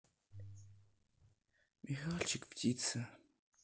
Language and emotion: Russian, sad